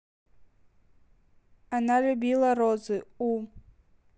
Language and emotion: Russian, neutral